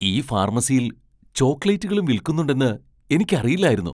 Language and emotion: Malayalam, surprised